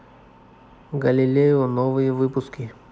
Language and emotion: Russian, neutral